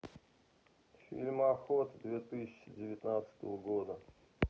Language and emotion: Russian, neutral